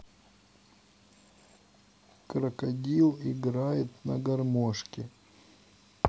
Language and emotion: Russian, neutral